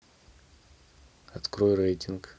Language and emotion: Russian, neutral